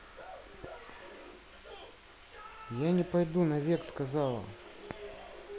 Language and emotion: Russian, neutral